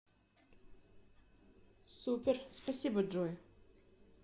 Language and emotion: Russian, neutral